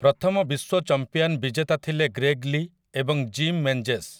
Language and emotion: Odia, neutral